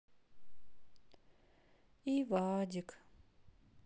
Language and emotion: Russian, sad